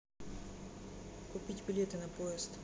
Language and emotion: Russian, neutral